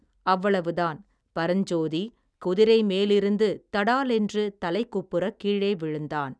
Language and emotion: Tamil, neutral